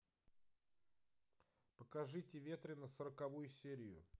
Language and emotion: Russian, neutral